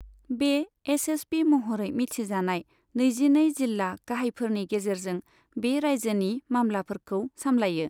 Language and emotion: Bodo, neutral